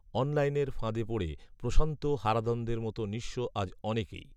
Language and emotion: Bengali, neutral